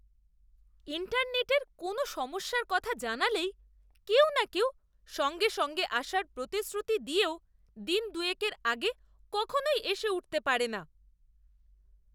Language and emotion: Bengali, disgusted